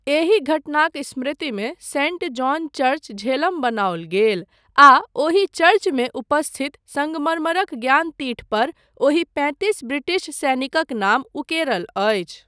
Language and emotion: Maithili, neutral